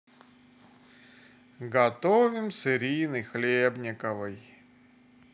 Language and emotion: Russian, sad